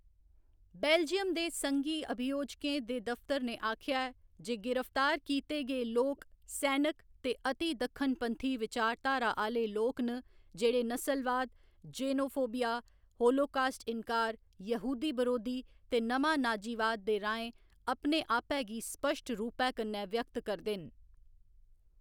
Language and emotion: Dogri, neutral